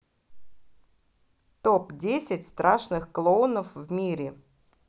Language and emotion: Russian, positive